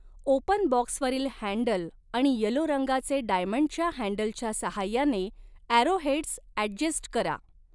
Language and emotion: Marathi, neutral